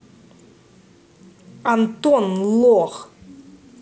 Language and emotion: Russian, angry